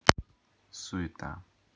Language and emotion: Russian, neutral